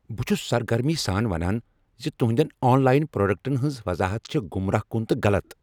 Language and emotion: Kashmiri, angry